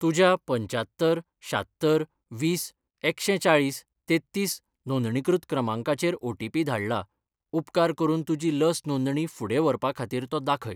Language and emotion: Goan Konkani, neutral